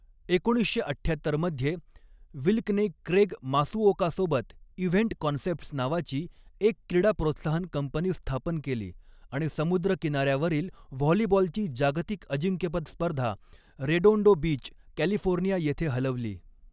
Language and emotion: Marathi, neutral